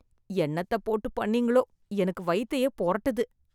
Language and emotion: Tamil, disgusted